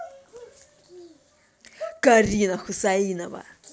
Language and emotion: Russian, angry